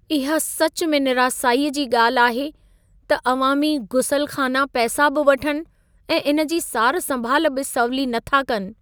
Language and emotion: Sindhi, sad